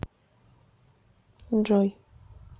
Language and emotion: Russian, neutral